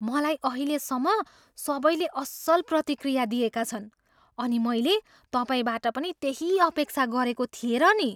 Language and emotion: Nepali, surprised